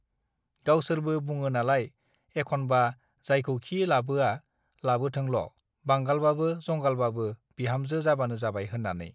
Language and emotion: Bodo, neutral